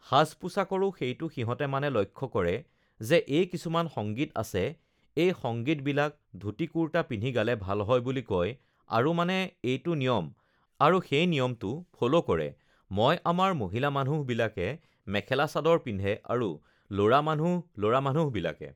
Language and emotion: Assamese, neutral